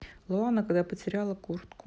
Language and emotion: Russian, neutral